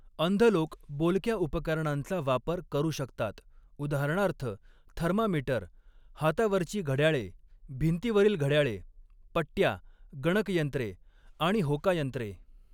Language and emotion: Marathi, neutral